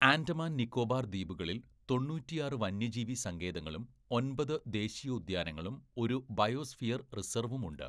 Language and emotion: Malayalam, neutral